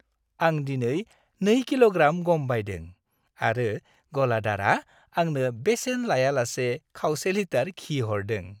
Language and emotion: Bodo, happy